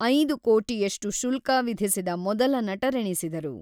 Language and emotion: Kannada, neutral